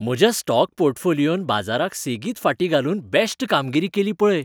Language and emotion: Goan Konkani, happy